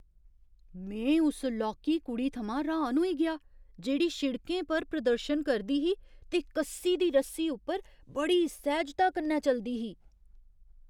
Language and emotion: Dogri, surprised